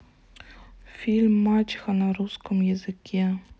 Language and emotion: Russian, neutral